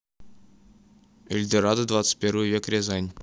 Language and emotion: Russian, neutral